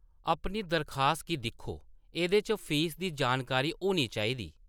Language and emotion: Dogri, neutral